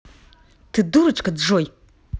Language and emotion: Russian, angry